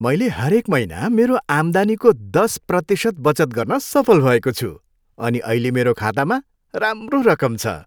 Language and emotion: Nepali, happy